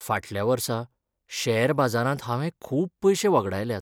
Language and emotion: Goan Konkani, sad